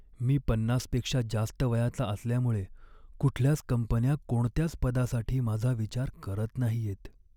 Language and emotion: Marathi, sad